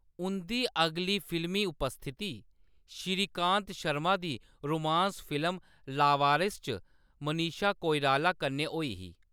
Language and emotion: Dogri, neutral